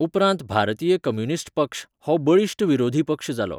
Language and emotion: Goan Konkani, neutral